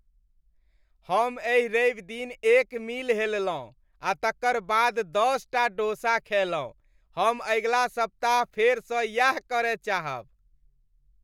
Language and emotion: Maithili, happy